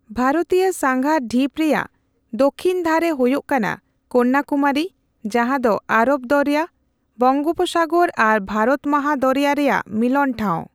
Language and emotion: Santali, neutral